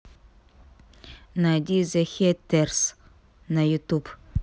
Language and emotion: Russian, neutral